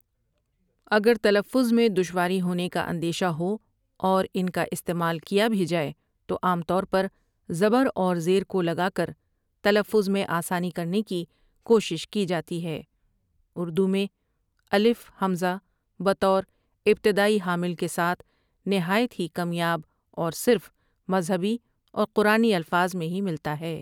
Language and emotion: Urdu, neutral